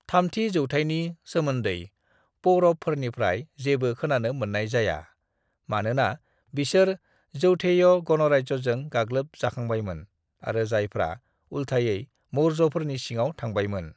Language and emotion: Bodo, neutral